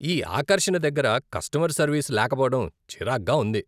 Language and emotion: Telugu, disgusted